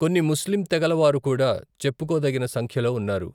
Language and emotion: Telugu, neutral